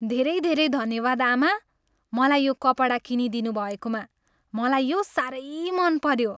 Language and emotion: Nepali, happy